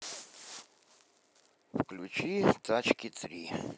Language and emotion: Russian, neutral